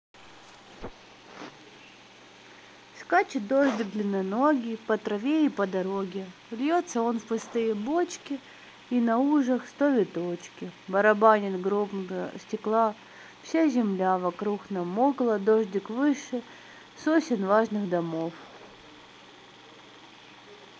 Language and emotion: Russian, sad